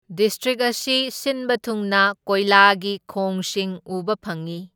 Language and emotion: Manipuri, neutral